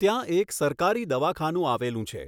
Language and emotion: Gujarati, neutral